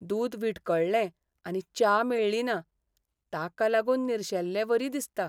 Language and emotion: Goan Konkani, sad